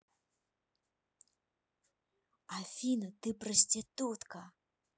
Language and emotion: Russian, angry